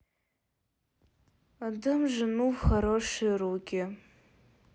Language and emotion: Russian, sad